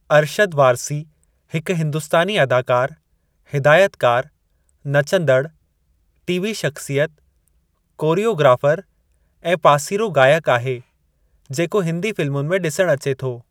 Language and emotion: Sindhi, neutral